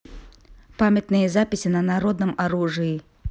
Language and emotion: Russian, neutral